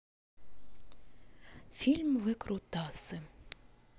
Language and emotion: Russian, neutral